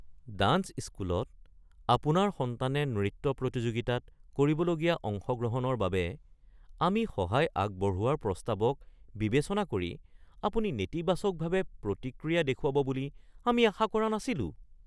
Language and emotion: Assamese, surprised